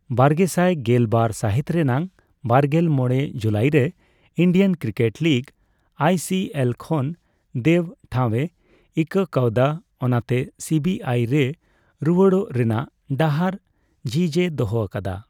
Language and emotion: Santali, neutral